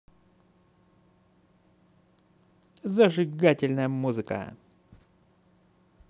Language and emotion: Russian, positive